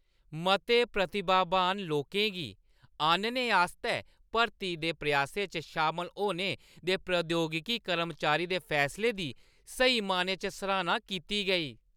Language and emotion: Dogri, happy